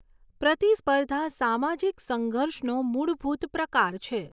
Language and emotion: Gujarati, neutral